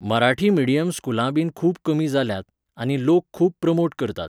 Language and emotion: Goan Konkani, neutral